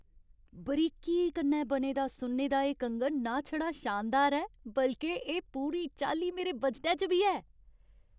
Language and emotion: Dogri, happy